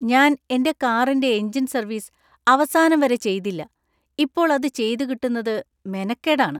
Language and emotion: Malayalam, disgusted